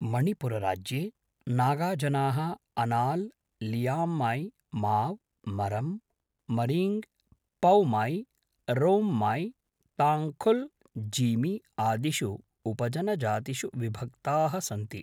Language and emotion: Sanskrit, neutral